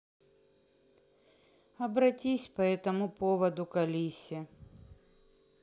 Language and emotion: Russian, neutral